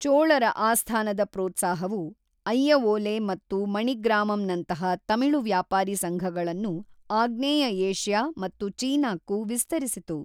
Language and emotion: Kannada, neutral